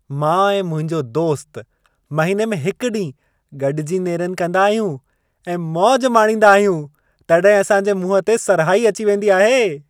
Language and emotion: Sindhi, happy